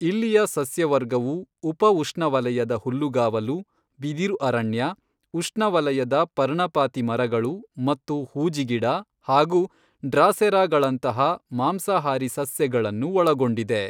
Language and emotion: Kannada, neutral